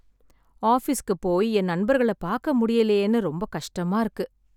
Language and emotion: Tamil, sad